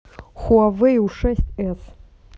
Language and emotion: Russian, neutral